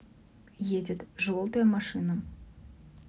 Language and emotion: Russian, neutral